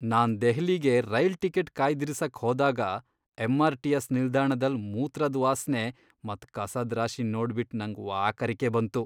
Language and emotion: Kannada, disgusted